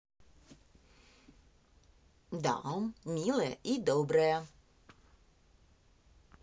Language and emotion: Russian, positive